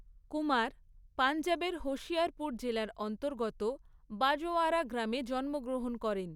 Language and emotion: Bengali, neutral